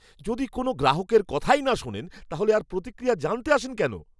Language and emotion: Bengali, angry